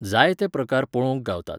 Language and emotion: Goan Konkani, neutral